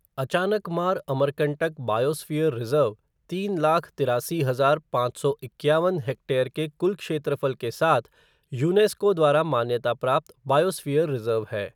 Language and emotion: Hindi, neutral